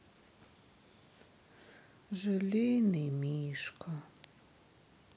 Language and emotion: Russian, sad